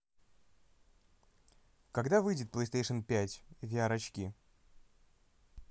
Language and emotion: Russian, neutral